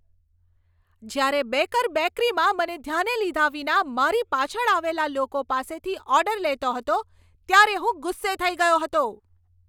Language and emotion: Gujarati, angry